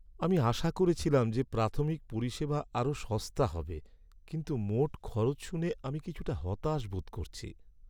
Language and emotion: Bengali, sad